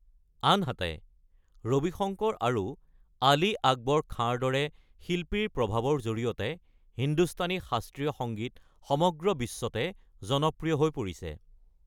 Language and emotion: Assamese, neutral